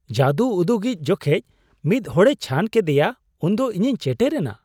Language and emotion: Santali, surprised